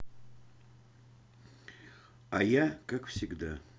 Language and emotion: Russian, sad